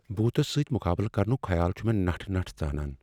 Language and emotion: Kashmiri, fearful